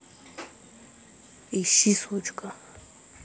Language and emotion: Russian, angry